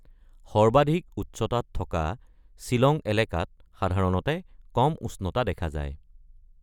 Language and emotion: Assamese, neutral